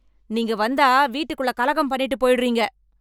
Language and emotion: Tamil, angry